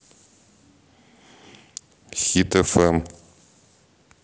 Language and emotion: Russian, neutral